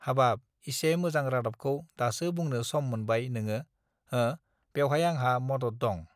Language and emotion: Bodo, neutral